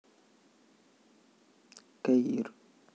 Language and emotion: Russian, neutral